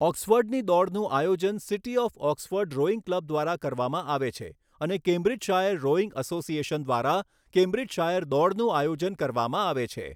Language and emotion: Gujarati, neutral